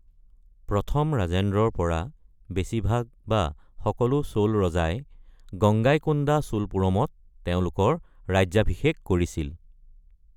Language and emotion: Assamese, neutral